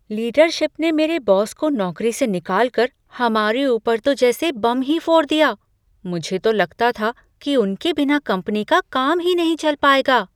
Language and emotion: Hindi, surprised